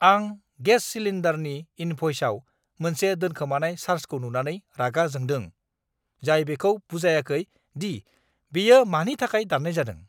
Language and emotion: Bodo, angry